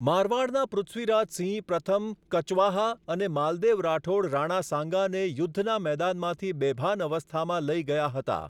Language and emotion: Gujarati, neutral